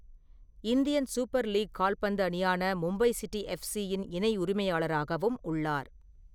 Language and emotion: Tamil, neutral